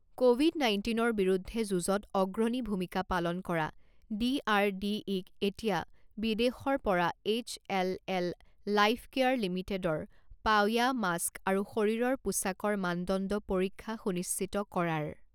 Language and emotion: Assamese, neutral